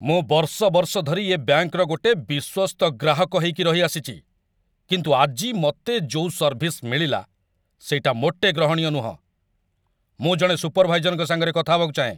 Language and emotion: Odia, angry